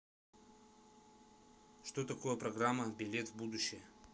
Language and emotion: Russian, neutral